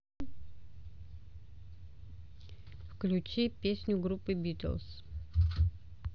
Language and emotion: Russian, neutral